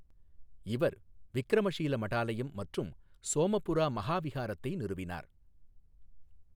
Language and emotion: Tamil, neutral